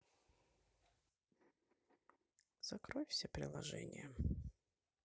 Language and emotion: Russian, sad